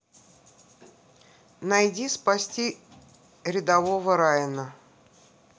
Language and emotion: Russian, neutral